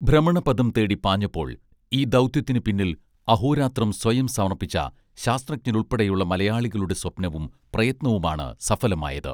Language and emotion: Malayalam, neutral